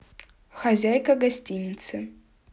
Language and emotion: Russian, neutral